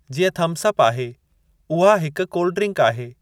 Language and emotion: Sindhi, neutral